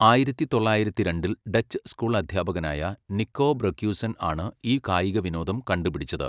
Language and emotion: Malayalam, neutral